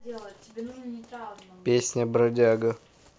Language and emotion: Russian, neutral